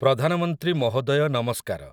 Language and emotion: Odia, neutral